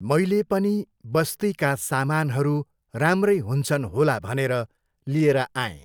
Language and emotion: Nepali, neutral